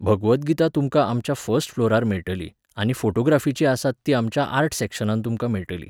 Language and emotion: Goan Konkani, neutral